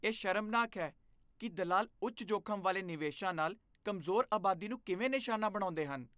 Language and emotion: Punjabi, disgusted